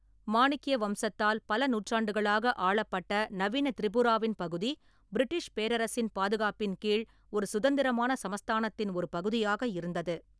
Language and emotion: Tamil, neutral